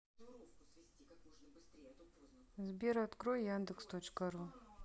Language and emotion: Russian, neutral